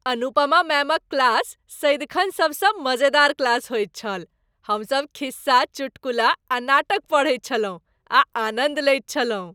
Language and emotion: Maithili, happy